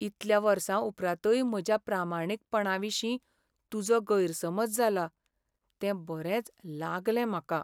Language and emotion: Goan Konkani, sad